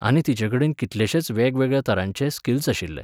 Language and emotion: Goan Konkani, neutral